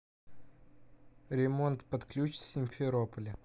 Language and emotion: Russian, neutral